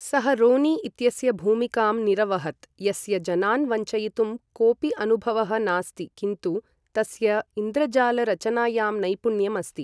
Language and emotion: Sanskrit, neutral